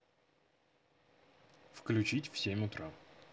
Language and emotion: Russian, neutral